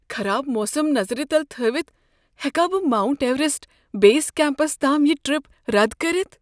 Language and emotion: Kashmiri, fearful